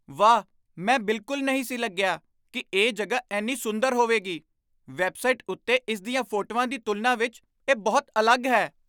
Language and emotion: Punjabi, surprised